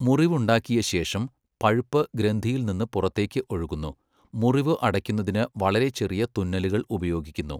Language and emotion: Malayalam, neutral